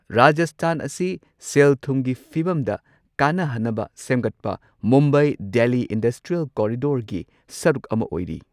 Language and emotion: Manipuri, neutral